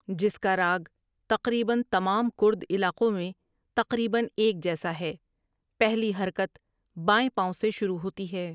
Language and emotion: Urdu, neutral